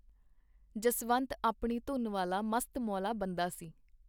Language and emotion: Punjabi, neutral